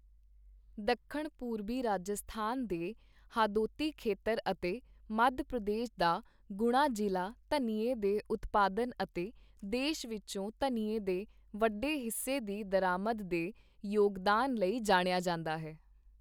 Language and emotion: Punjabi, neutral